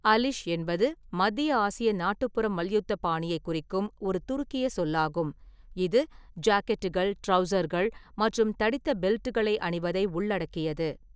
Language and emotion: Tamil, neutral